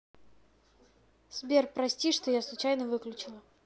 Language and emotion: Russian, neutral